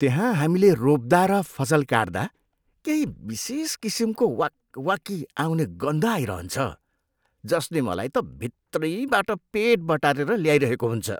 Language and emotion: Nepali, disgusted